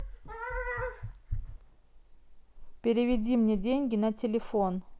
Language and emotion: Russian, neutral